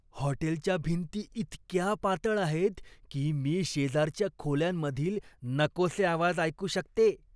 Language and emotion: Marathi, disgusted